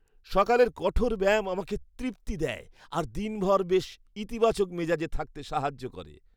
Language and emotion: Bengali, happy